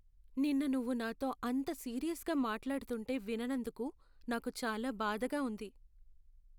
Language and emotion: Telugu, sad